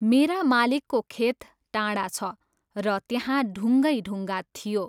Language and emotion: Nepali, neutral